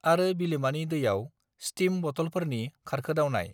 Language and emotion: Bodo, neutral